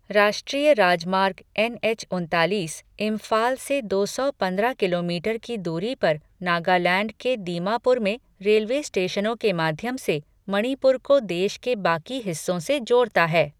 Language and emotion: Hindi, neutral